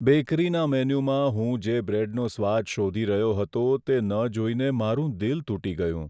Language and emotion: Gujarati, sad